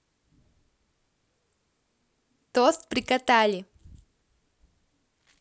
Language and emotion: Russian, positive